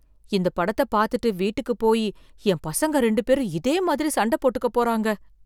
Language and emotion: Tamil, fearful